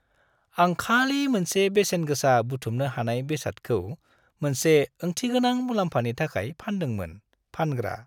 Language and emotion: Bodo, happy